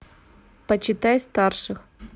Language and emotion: Russian, neutral